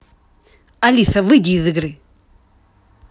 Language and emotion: Russian, angry